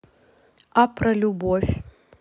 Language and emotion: Russian, neutral